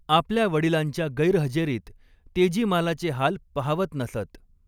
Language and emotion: Marathi, neutral